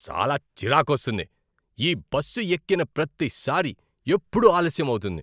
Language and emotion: Telugu, angry